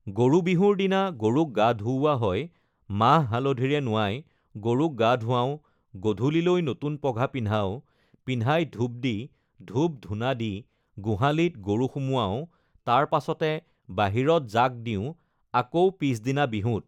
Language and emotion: Assamese, neutral